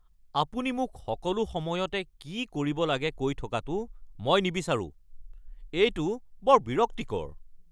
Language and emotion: Assamese, angry